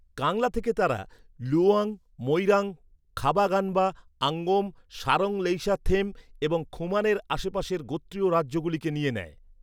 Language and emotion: Bengali, neutral